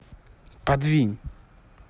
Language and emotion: Russian, angry